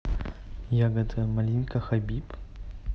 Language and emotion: Russian, neutral